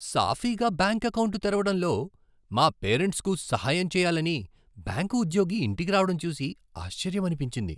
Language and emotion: Telugu, surprised